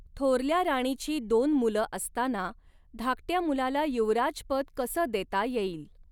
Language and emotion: Marathi, neutral